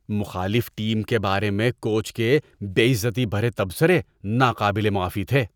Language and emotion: Urdu, disgusted